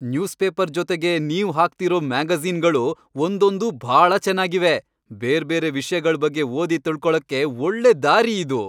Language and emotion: Kannada, happy